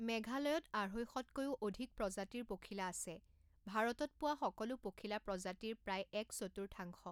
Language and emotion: Assamese, neutral